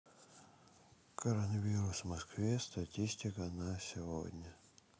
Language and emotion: Russian, sad